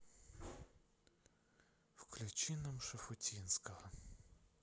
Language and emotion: Russian, sad